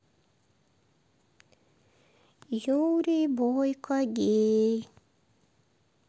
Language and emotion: Russian, neutral